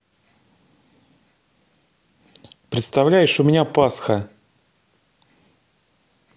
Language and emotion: Russian, neutral